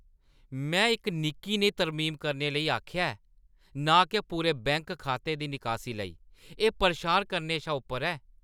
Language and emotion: Dogri, angry